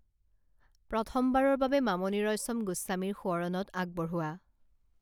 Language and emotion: Assamese, neutral